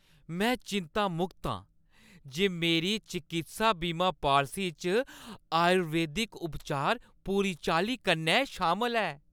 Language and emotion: Dogri, happy